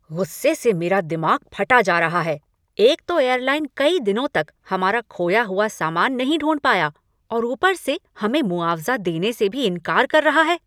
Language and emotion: Hindi, angry